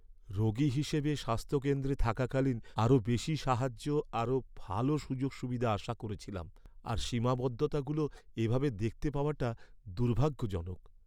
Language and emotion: Bengali, sad